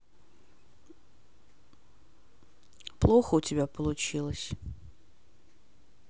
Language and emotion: Russian, sad